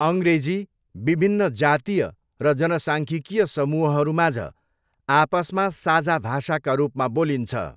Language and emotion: Nepali, neutral